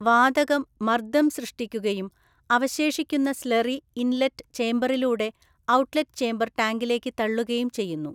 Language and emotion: Malayalam, neutral